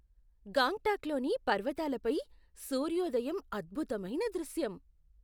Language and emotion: Telugu, surprised